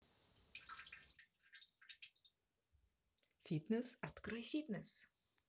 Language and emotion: Russian, positive